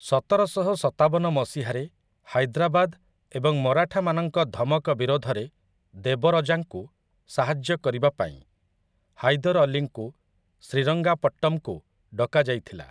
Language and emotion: Odia, neutral